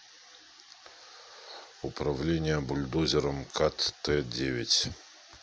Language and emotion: Russian, neutral